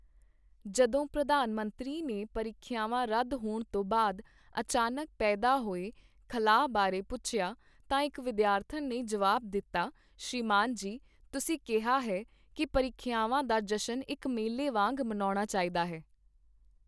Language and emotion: Punjabi, neutral